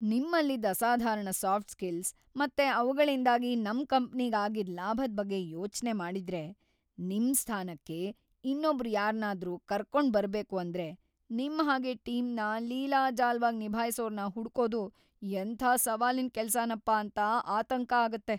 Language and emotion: Kannada, fearful